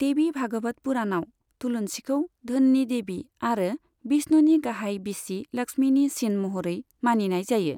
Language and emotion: Bodo, neutral